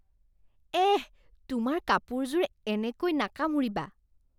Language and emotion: Assamese, disgusted